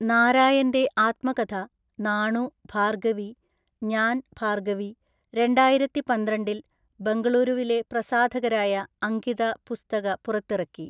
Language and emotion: Malayalam, neutral